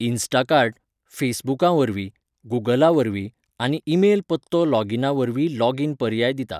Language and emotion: Goan Konkani, neutral